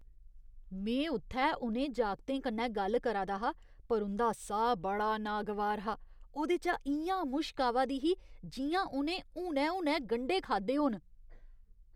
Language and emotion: Dogri, disgusted